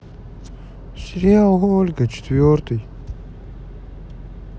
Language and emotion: Russian, sad